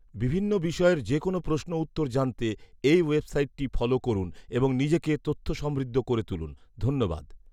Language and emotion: Bengali, neutral